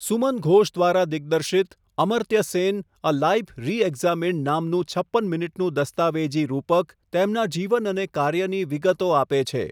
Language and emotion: Gujarati, neutral